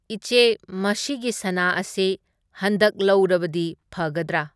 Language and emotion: Manipuri, neutral